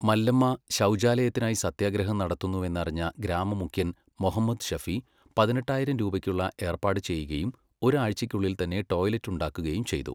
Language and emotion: Malayalam, neutral